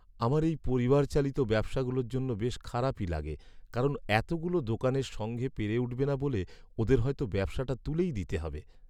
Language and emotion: Bengali, sad